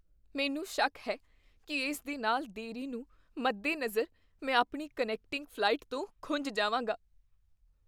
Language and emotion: Punjabi, fearful